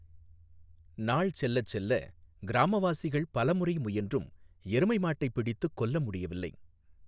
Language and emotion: Tamil, neutral